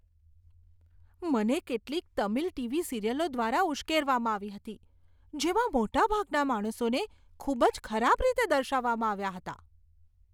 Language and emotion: Gujarati, disgusted